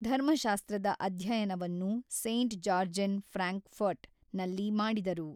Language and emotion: Kannada, neutral